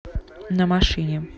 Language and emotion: Russian, neutral